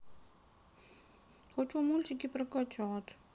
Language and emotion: Russian, sad